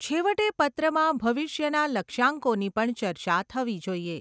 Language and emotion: Gujarati, neutral